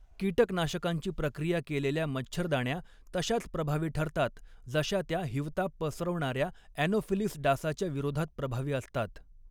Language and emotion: Marathi, neutral